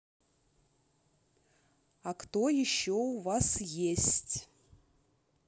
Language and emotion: Russian, neutral